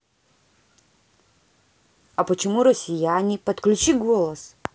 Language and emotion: Russian, neutral